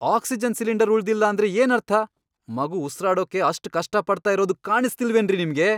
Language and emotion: Kannada, angry